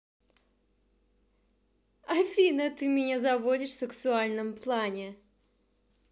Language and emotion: Russian, positive